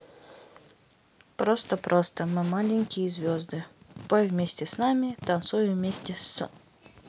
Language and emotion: Russian, neutral